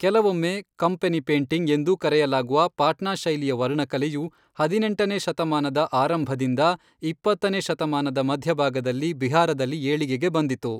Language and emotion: Kannada, neutral